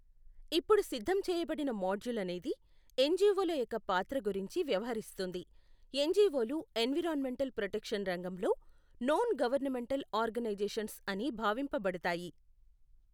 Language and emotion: Telugu, neutral